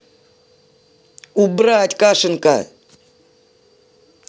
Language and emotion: Russian, angry